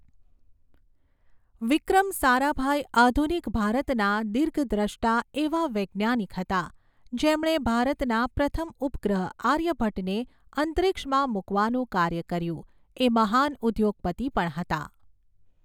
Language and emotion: Gujarati, neutral